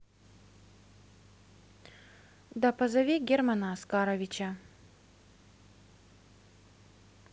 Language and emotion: Russian, neutral